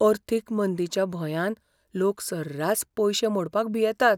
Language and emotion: Goan Konkani, fearful